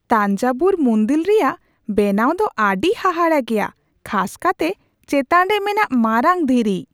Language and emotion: Santali, surprised